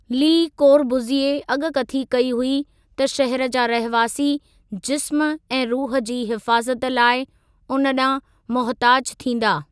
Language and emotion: Sindhi, neutral